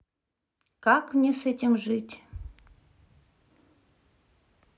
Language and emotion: Russian, sad